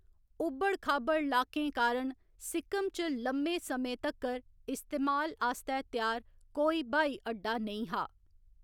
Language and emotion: Dogri, neutral